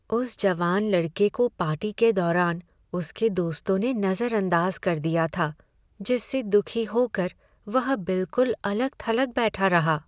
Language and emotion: Hindi, sad